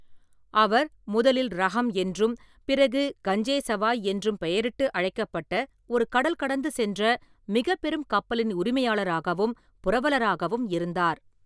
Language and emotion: Tamil, neutral